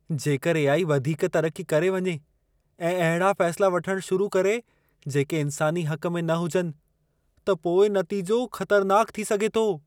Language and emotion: Sindhi, fearful